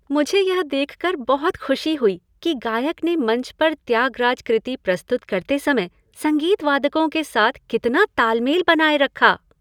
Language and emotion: Hindi, happy